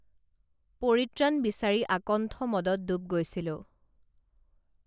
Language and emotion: Assamese, neutral